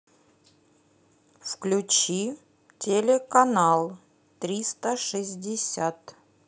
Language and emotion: Russian, neutral